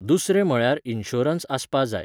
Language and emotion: Goan Konkani, neutral